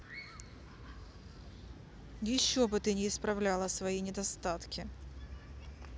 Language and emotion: Russian, angry